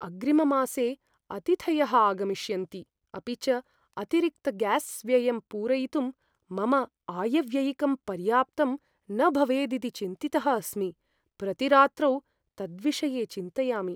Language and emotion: Sanskrit, fearful